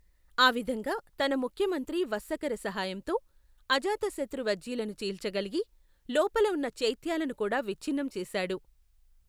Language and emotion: Telugu, neutral